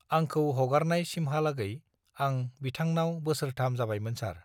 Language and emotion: Bodo, neutral